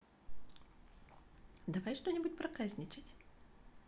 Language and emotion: Russian, positive